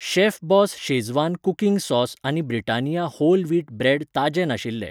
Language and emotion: Goan Konkani, neutral